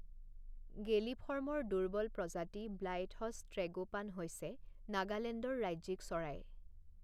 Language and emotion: Assamese, neutral